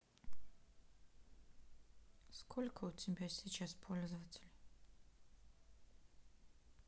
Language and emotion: Russian, sad